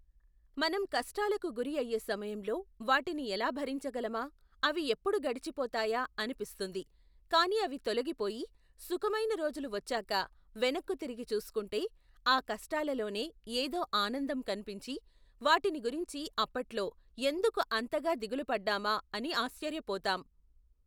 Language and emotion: Telugu, neutral